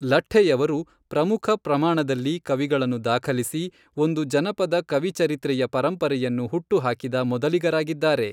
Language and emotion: Kannada, neutral